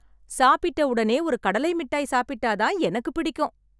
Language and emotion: Tamil, happy